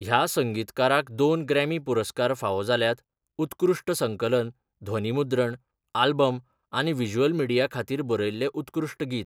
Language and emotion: Goan Konkani, neutral